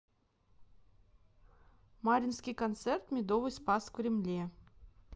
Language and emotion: Russian, neutral